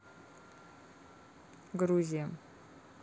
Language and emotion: Russian, neutral